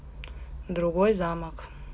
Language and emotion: Russian, neutral